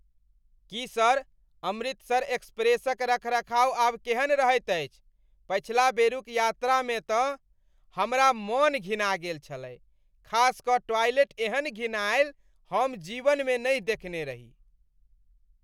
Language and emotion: Maithili, disgusted